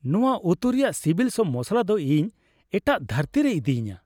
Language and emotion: Santali, happy